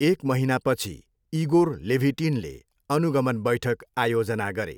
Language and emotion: Nepali, neutral